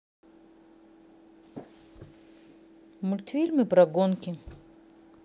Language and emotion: Russian, neutral